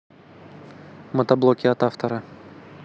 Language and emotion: Russian, neutral